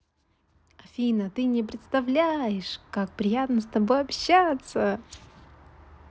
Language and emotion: Russian, positive